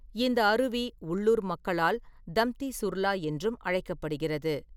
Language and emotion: Tamil, neutral